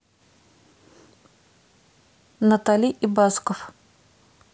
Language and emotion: Russian, neutral